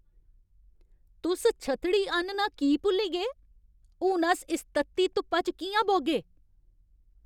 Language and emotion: Dogri, angry